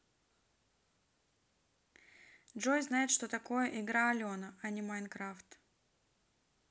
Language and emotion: Russian, neutral